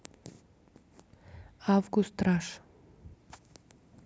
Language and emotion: Russian, neutral